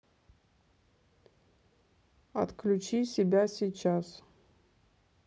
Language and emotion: Russian, neutral